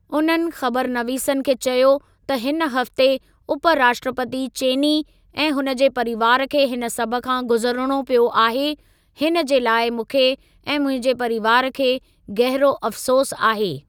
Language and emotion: Sindhi, neutral